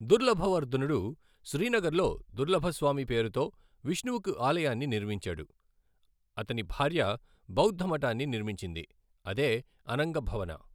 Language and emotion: Telugu, neutral